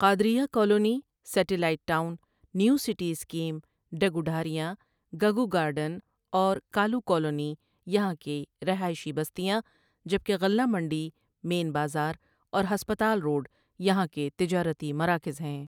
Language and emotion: Urdu, neutral